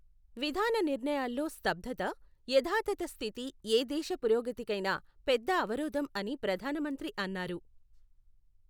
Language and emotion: Telugu, neutral